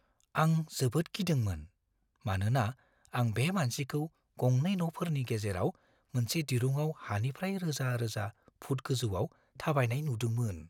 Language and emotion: Bodo, fearful